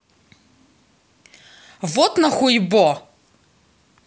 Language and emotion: Russian, angry